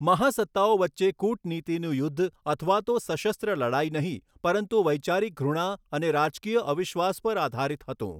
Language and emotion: Gujarati, neutral